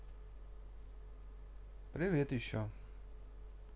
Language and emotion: Russian, neutral